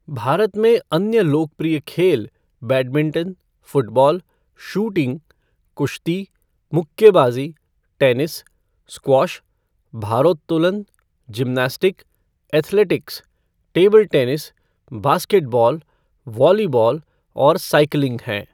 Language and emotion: Hindi, neutral